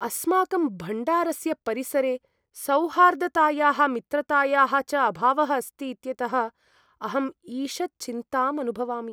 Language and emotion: Sanskrit, sad